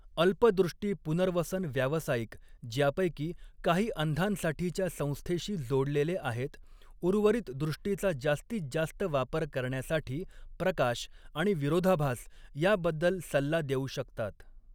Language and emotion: Marathi, neutral